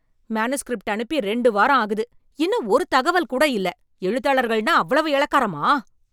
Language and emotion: Tamil, angry